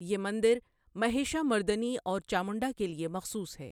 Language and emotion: Urdu, neutral